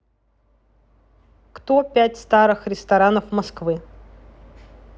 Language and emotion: Russian, neutral